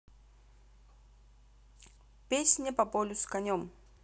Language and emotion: Russian, neutral